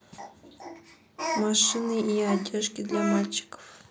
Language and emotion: Russian, neutral